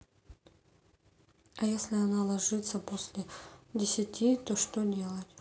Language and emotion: Russian, neutral